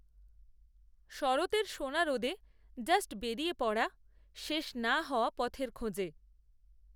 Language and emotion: Bengali, neutral